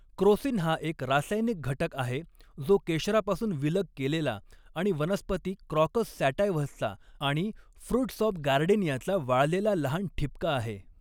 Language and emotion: Marathi, neutral